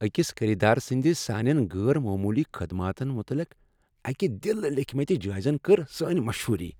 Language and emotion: Kashmiri, happy